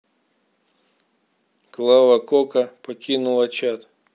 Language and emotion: Russian, neutral